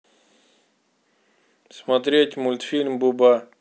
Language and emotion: Russian, neutral